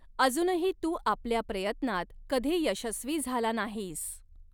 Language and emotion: Marathi, neutral